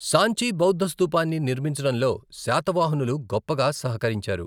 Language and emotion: Telugu, neutral